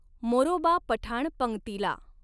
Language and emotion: Marathi, neutral